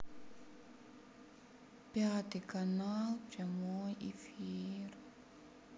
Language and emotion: Russian, sad